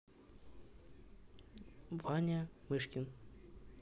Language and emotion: Russian, neutral